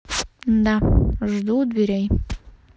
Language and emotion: Russian, neutral